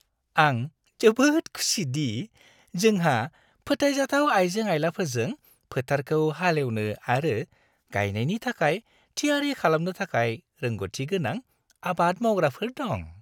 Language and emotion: Bodo, happy